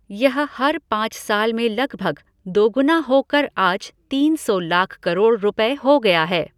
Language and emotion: Hindi, neutral